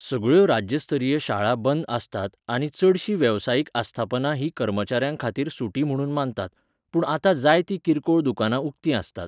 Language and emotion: Goan Konkani, neutral